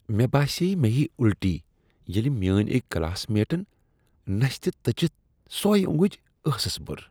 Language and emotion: Kashmiri, disgusted